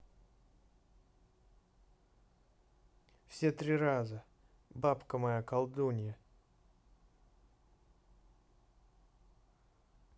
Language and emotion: Russian, neutral